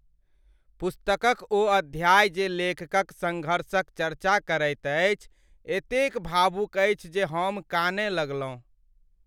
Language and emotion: Maithili, sad